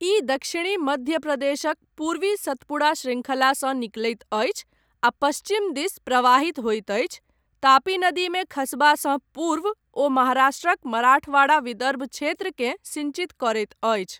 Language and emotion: Maithili, neutral